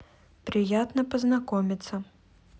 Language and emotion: Russian, neutral